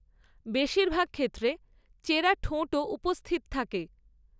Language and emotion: Bengali, neutral